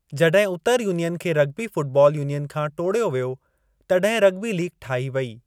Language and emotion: Sindhi, neutral